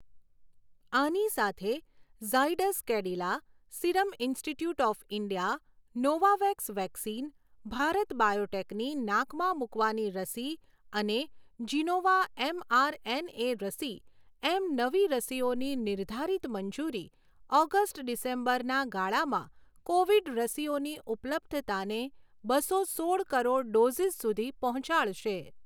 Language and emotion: Gujarati, neutral